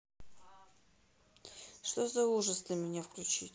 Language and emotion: Russian, neutral